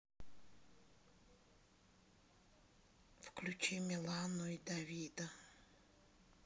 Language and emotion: Russian, sad